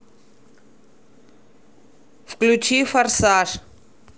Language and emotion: Russian, neutral